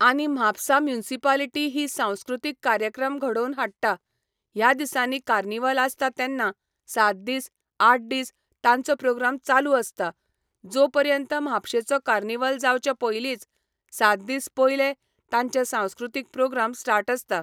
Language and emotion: Goan Konkani, neutral